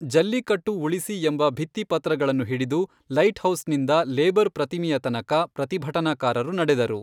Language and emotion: Kannada, neutral